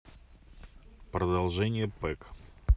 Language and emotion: Russian, neutral